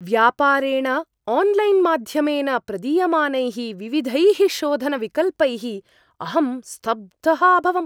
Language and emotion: Sanskrit, surprised